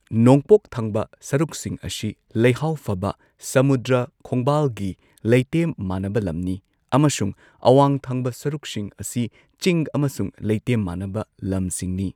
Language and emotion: Manipuri, neutral